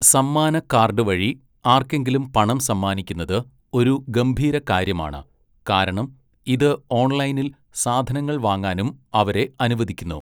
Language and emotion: Malayalam, neutral